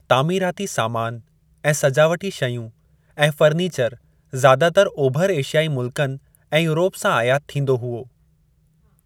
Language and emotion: Sindhi, neutral